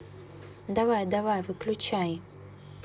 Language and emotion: Russian, neutral